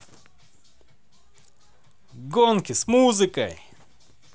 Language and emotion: Russian, positive